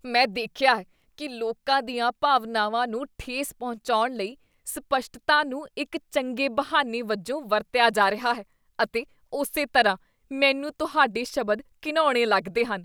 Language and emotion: Punjabi, disgusted